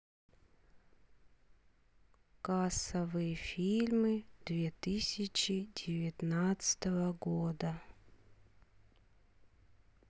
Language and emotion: Russian, sad